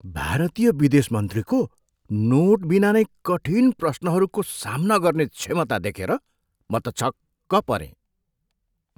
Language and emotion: Nepali, surprised